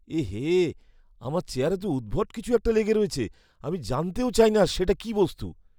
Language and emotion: Bengali, disgusted